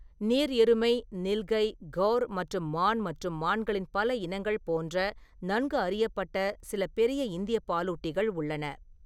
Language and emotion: Tamil, neutral